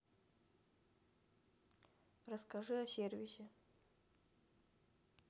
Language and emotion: Russian, neutral